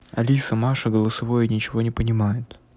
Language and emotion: Russian, neutral